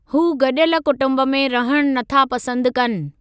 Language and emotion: Sindhi, neutral